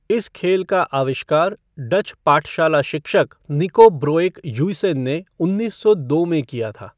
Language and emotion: Hindi, neutral